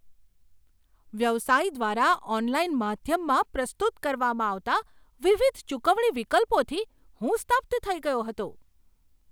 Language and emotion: Gujarati, surprised